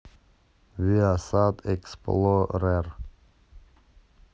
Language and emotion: Russian, neutral